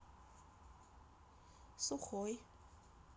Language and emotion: Russian, neutral